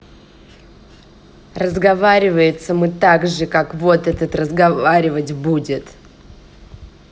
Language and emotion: Russian, angry